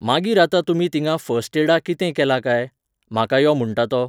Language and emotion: Goan Konkani, neutral